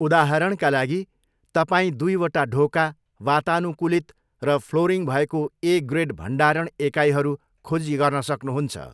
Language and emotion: Nepali, neutral